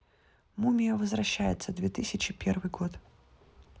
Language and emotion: Russian, neutral